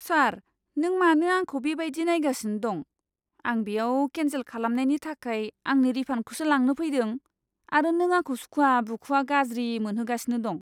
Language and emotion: Bodo, disgusted